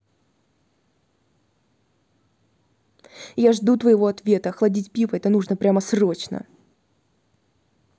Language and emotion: Russian, angry